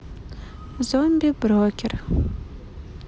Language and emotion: Russian, neutral